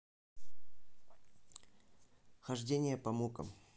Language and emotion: Russian, neutral